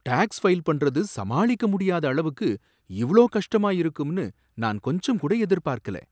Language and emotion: Tamil, surprised